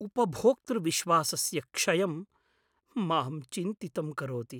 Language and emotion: Sanskrit, fearful